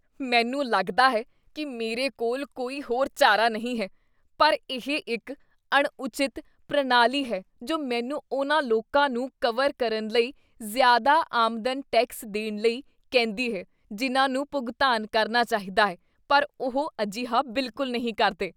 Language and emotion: Punjabi, disgusted